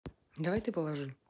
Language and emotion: Russian, neutral